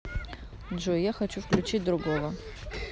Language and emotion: Russian, neutral